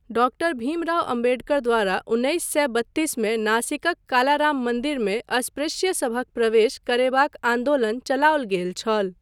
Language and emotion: Maithili, neutral